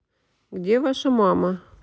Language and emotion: Russian, neutral